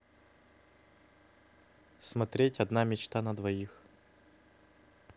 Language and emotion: Russian, neutral